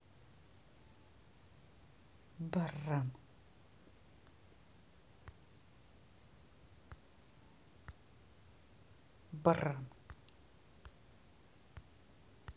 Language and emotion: Russian, angry